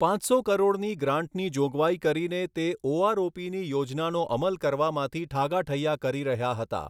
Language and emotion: Gujarati, neutral